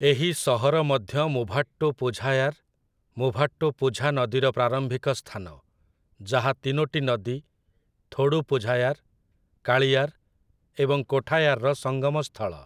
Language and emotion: Odia, neutral